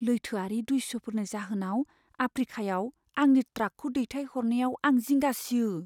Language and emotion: Bodo, fearful